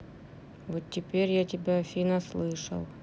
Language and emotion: Russian, sad